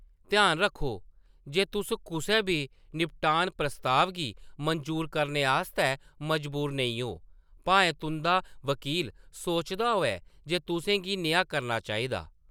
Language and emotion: Dogri, neutral